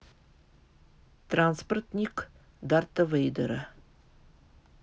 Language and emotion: Russian, neutral